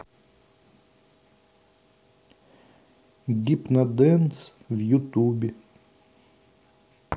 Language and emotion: Russian, neutral